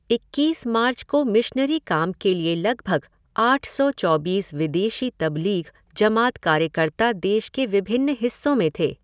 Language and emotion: Hindi, neutral